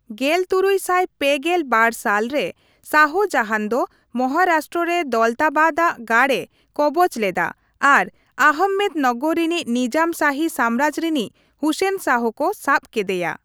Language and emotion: Santali, neutral